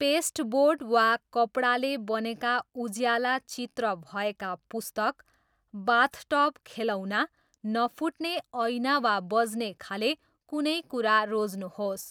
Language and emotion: Nepali, neutral